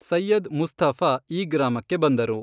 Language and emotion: Kannada, neutral